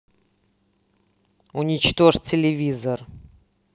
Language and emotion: Russian, angry